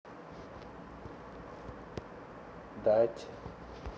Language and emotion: Russian, neutral